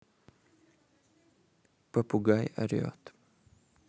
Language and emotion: Russian, neutral